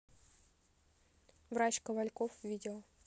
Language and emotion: Russian, neutral